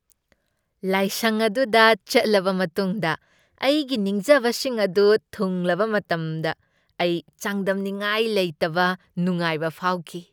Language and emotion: Manipuri, happy